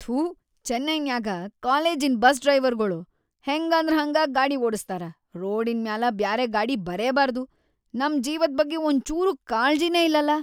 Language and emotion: Kannada, disgusted